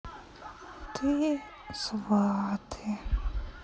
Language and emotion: Russian, sad